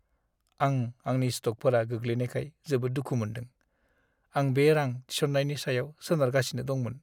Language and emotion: Bodo, sad